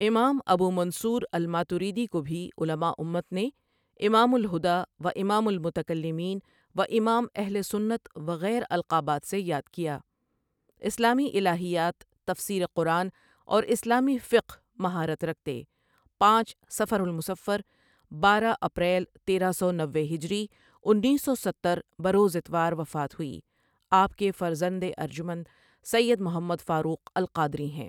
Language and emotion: Urdu, neutral